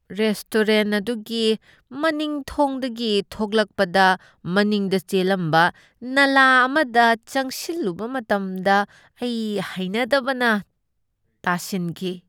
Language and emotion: Manipuri, disgusted